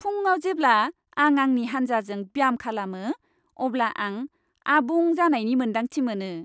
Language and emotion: Bodo, happy